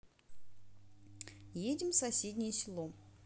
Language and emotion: Russian, neutral